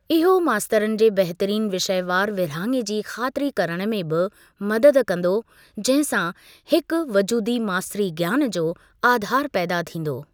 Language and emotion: Sindhi, neutral